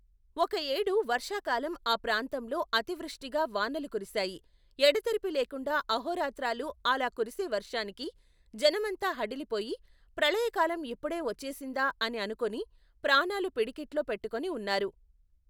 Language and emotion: Telugu, neutral